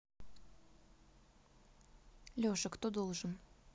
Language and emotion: Russian, neutral